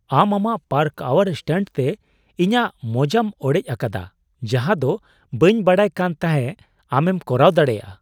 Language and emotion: Santali, surprised